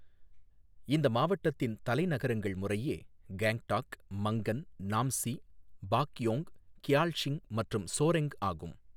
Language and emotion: Tamil, neutral